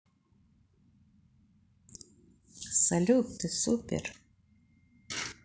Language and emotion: Russian, positive